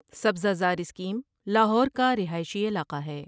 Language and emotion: Urdu, neutral